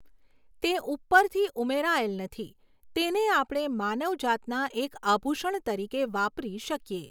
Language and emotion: Gujarati, neutral